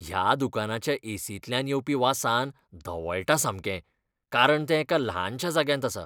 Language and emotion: Goan Konkani, disgusted